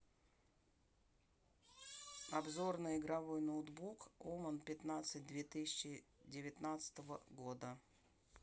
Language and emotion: Russian, neutral